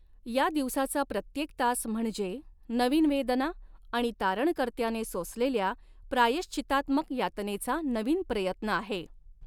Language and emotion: Marathi, neutral